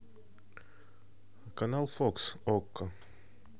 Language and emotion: Russian, neutral